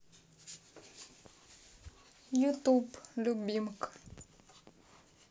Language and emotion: Russian, sad